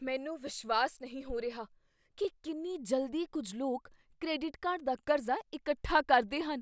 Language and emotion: Punjabi, surprised